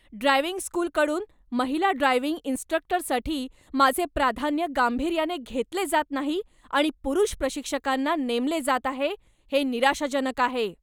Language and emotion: Marathi, angry